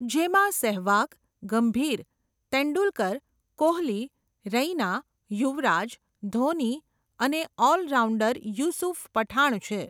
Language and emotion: Gujarati, neutral